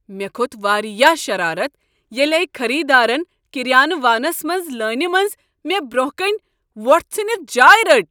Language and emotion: Kashmiri, angry